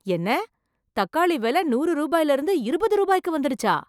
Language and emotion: Tamil, surprised